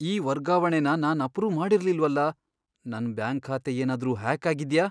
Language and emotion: Kannada, fearful